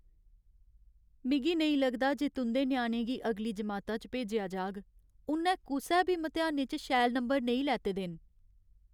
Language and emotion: Dogri, sad